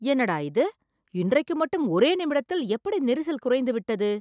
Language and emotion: Tamil, surprised